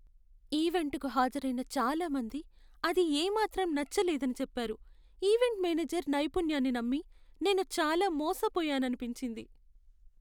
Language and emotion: Telugu, sad